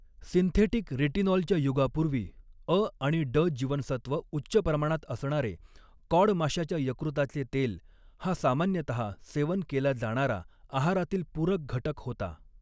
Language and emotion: Marathi, neutral